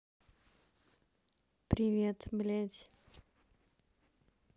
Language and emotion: Russian, neutral